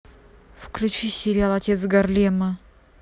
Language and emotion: Russian, angry